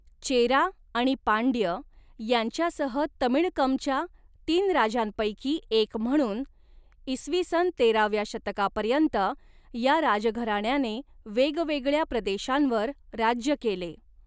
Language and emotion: Marathi, neutral